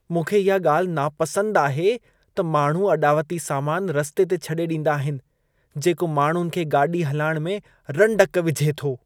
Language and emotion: Sindhi, disgusted